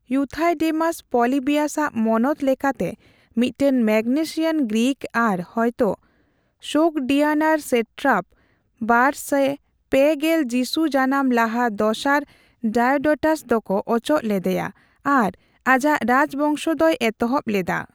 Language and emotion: Santali, neutral